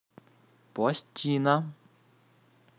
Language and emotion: Russian, neutral